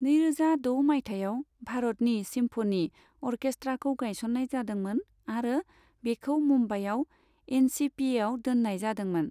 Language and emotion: Bodo, neutral